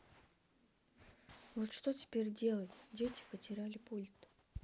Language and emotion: Russian, sad